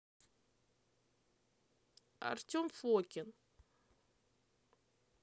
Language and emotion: Russian, neutral